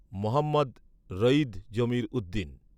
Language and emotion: Bengali, neutral